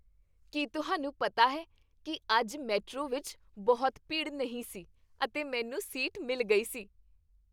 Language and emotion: Punjabi, happy